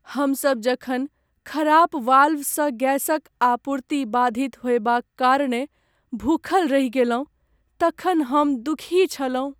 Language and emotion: Maithili, sad